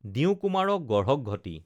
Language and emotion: Assamese, neutral